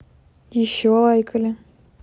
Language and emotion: Russian, neutral